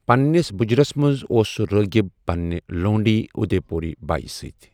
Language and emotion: Kashmiri, neutral